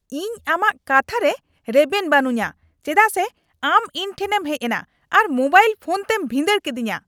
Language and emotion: Santali, angry